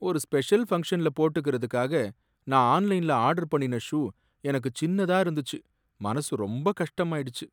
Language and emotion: Tamil, sad